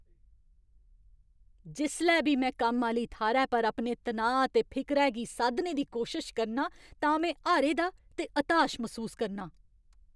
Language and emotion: Dogri, angry